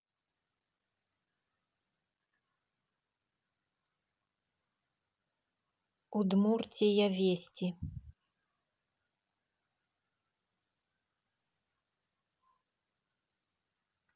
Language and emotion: Russian, neutral